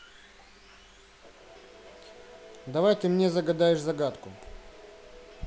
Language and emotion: Russian, neutral